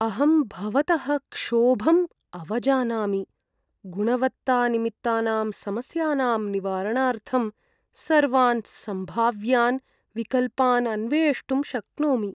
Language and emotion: Sanskrit, sad